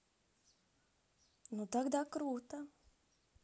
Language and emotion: Russian, positive